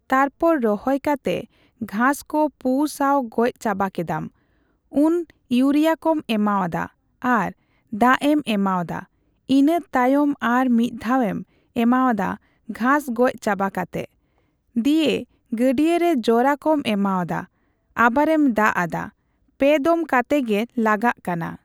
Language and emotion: Santali, neutral